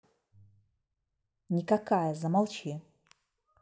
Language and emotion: Russian, neutral